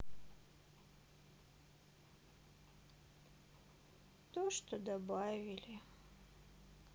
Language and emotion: Russian, sad